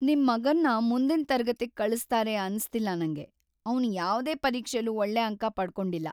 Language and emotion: Kannada, sad